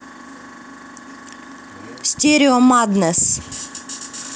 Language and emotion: Russian, neutral